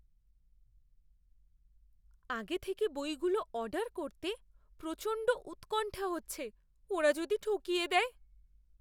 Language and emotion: Bengali, fearful